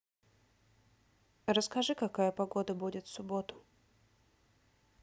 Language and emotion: Russian, neutral